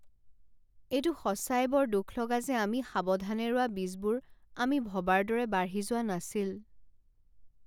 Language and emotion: Assamese, sad